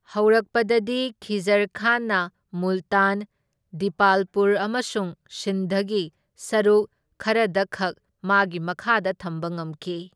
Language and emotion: Manipuri, neutral